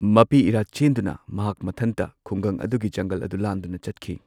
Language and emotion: Manipuri, neutral